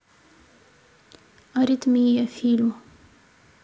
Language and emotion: Russian, neutral